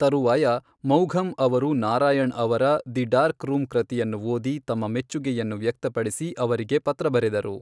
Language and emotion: Kannada, neutral